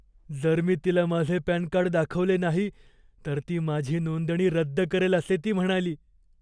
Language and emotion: Marathi, fearful